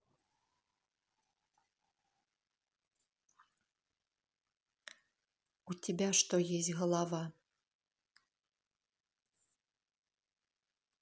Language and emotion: Russian, neutral